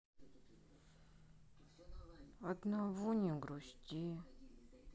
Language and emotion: Russian, sad